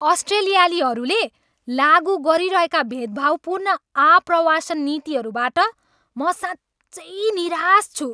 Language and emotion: Nepali, angry